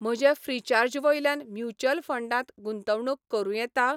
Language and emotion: Goan Konkani, neutral